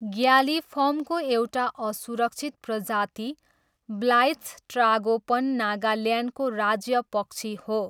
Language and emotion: Nepali, neutral